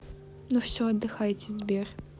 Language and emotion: Russian, neutral